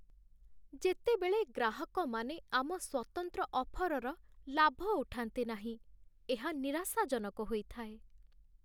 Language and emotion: Odia, sad